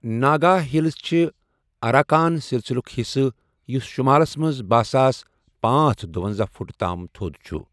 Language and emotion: Kashmiri, neutral